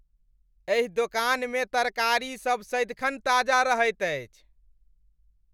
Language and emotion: Maithili, happy